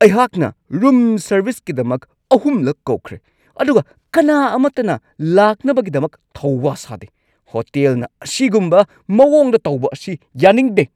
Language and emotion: Manipuri, angry